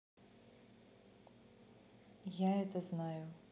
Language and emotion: Russian, neutral